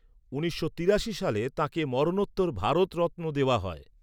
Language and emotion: Bengali, neutral